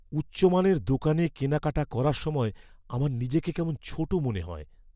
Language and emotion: Bengali, fearful